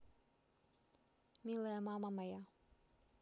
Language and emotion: Russian, neutral